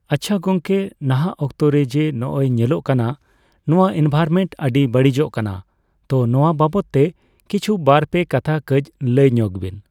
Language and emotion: Santali, neutral